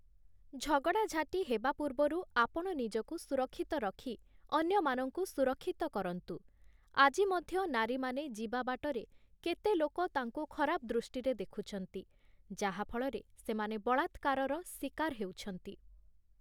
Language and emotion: Odia, neutral